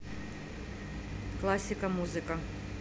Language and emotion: Russian, neutral